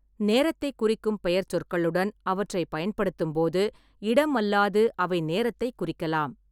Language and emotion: Tamil, neutral